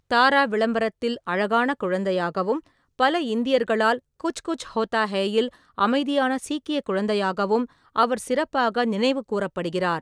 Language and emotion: Tamil, neutral